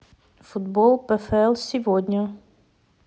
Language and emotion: Russian, neutral